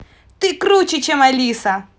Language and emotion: Russian, positive